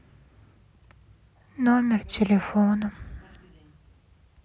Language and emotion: Russian, sad